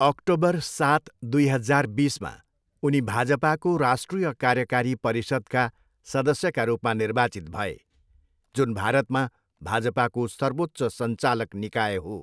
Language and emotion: Nepali, neutral